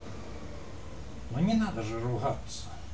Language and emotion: Russian, neutral